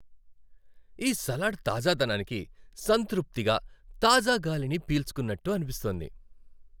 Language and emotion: Telugu, happy